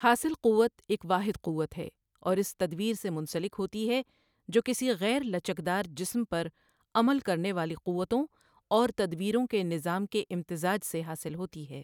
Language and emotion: Urdu, neutral